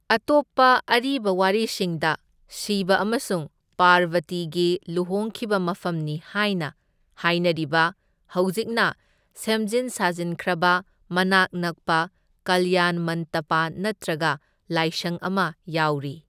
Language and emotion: Manipuri, neutral